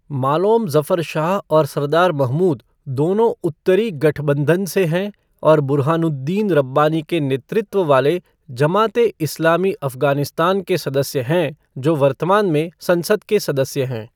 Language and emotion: Hindi, neutral